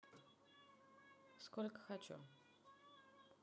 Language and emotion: Russian, neutral